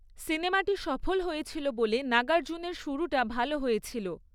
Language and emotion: Bengali, neutral